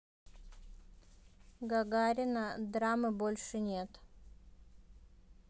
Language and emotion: Russian, neutral